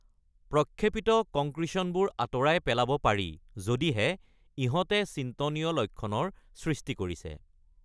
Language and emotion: Assamese, neutral